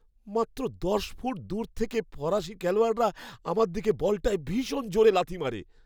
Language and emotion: Bengali, fearful